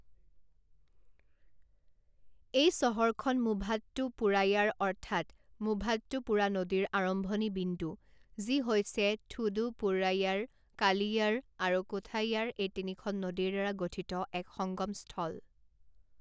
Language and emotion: Assamese, neutral